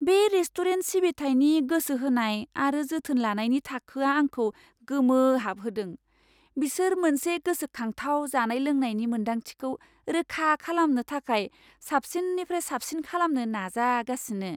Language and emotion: Bodo, surprised